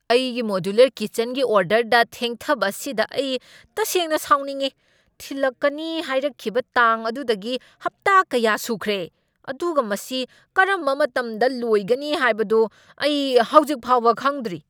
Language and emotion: Manipuri, angry